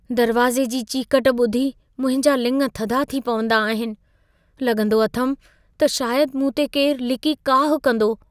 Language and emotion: Sindhi, fearful